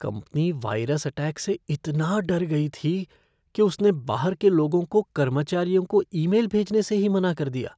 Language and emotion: Hindi, fearful